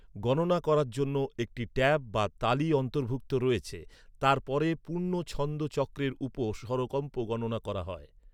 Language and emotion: Bengali, neutral